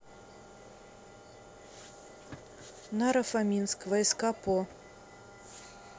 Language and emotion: Russian, neutral